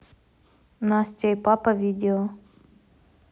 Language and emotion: Russian, neutral